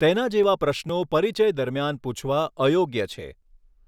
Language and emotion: Gujarati, neutral